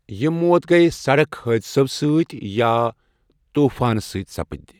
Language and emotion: Kashmiri, neutral